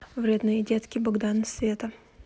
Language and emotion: Russian, neutral